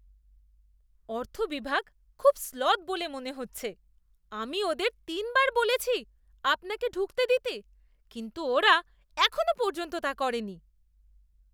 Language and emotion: Bengali, disgusted